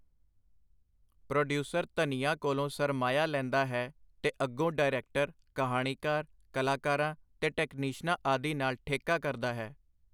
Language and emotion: Punjabi, neutral